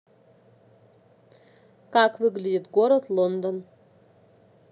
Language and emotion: Russian, neutral